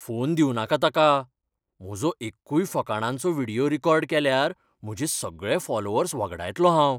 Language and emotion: Goan Konkani, fearful